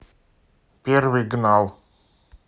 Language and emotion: Russian, neutral